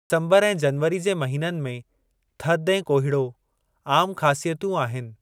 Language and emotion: Sindhi, neutral